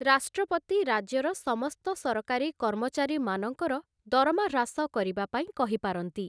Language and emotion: Odia, neutral